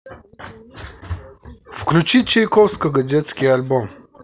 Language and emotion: Russian, neutral